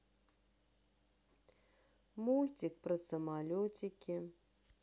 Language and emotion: Russian, sad